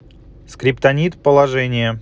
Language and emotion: Russian, neutral